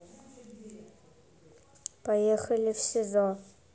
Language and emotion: Russian, neutral